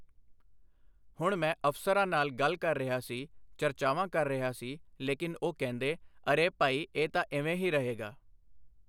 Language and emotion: Punjabi, neutral